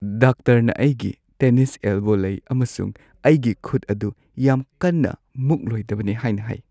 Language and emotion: Manipuri, sad